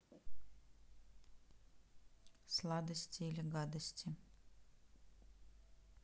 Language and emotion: Russian, neutral